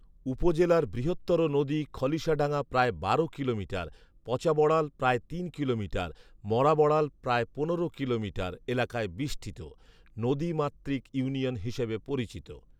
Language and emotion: Bengali, neutral